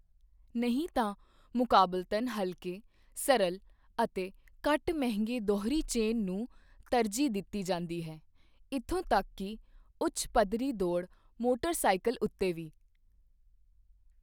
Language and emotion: Punjabi, neutral